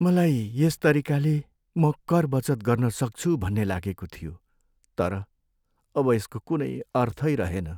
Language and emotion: Nepali, sad